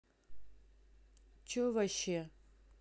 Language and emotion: Russian, angry